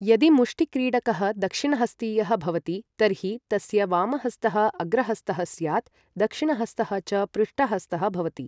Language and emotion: Sanskrit, neutral